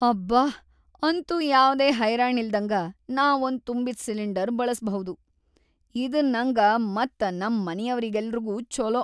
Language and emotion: Kannada, happy